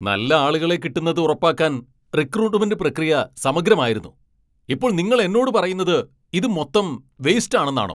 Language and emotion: Malayalam, angry